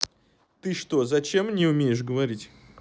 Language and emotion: Russian, neutral